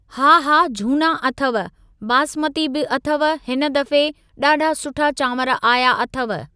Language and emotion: Sindhi, neutral